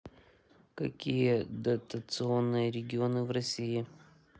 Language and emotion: Russian, neutral